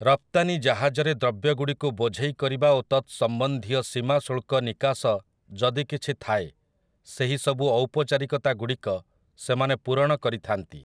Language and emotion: Odia, neutral